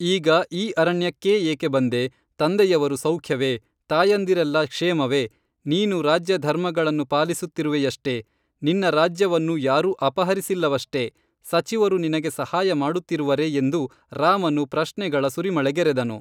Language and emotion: Kannada, neutral